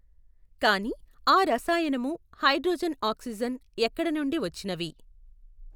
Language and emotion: Telugu, neutral